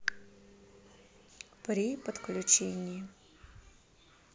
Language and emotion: Russian, neutral